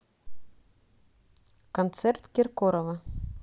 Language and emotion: Russian, neutral